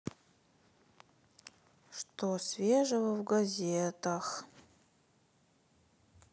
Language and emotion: Russian, sad